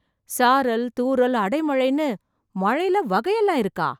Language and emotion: Tamil, surprised